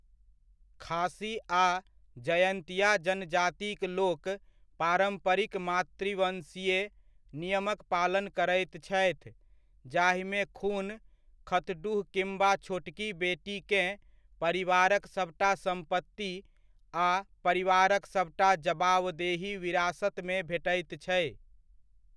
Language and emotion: Maithili, neutral